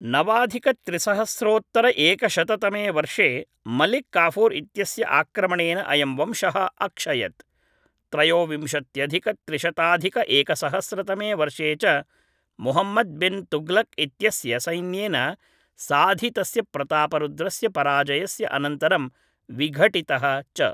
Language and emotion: Sanskrit, neutral